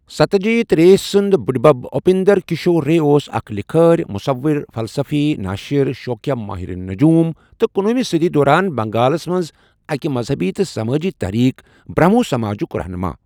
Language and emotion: Kashmiri, neutral